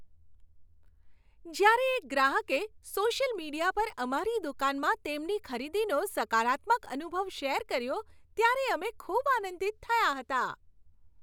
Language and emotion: Gujarati, happy